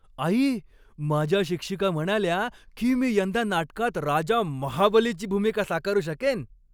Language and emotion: Marathi, happy